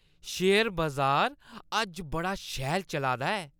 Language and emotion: Dogri, happy